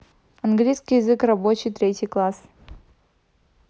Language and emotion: Russian, neutral